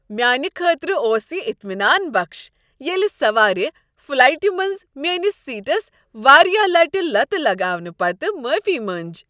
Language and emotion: Kashmiri, happy